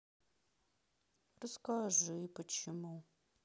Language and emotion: Russian, sad